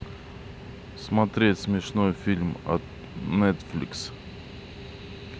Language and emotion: Russian, neutral